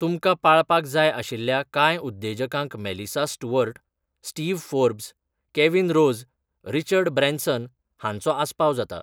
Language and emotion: Goan Konkani, neutral